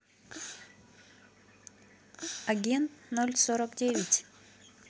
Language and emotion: Russian, neutral